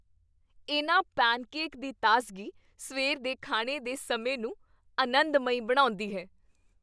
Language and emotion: Punjabi, happy